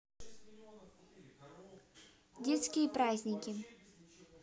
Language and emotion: Russian, neutral